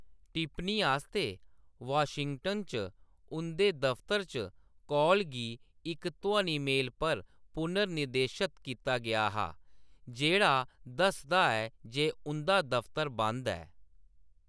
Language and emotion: Dogri, neutral